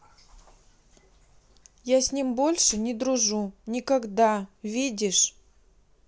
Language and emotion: Russian, neutral